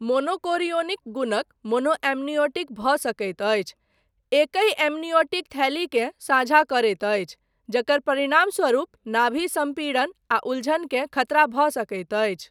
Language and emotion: Maithili, neutral